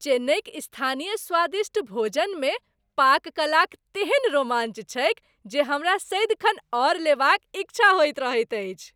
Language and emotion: Maithili, happy